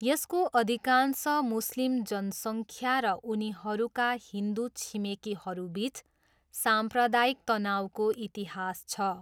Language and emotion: Nepali, neutral